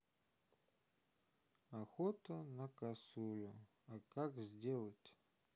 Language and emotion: Russian, sad